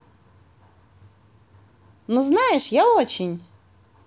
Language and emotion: Russian, positive